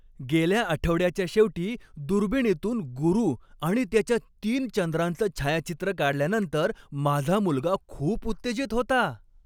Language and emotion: Marathi, happy